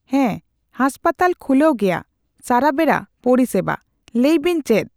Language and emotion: Santali, neutral